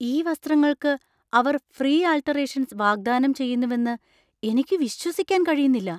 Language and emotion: Malayalam, surprised